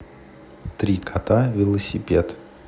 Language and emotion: Russian, neutral